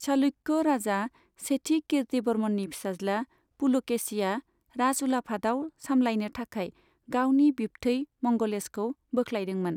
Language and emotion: Bodo, neutral